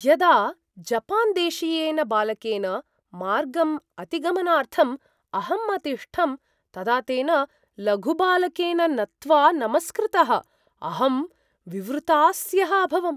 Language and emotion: Sanskrit, surprised